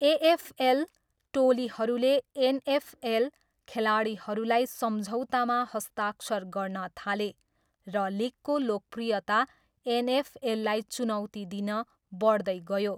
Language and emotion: Nepali, neutral